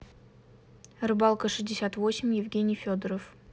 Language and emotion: Russian, neutral